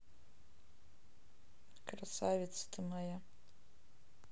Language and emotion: Russian, neutral